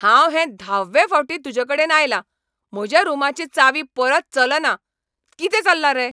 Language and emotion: Goan Konkani, angry